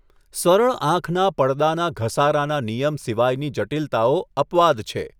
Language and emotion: Gujarati, neutral